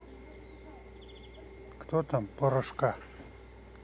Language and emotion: Russian, neutral